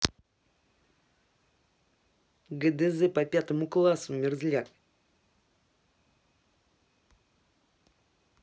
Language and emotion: Russian, angry